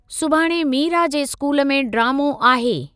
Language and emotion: Sindhi, neutral